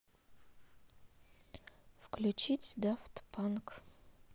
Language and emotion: Russian, neutral